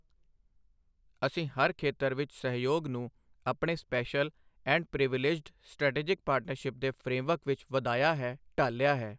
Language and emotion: Punjabi, neutral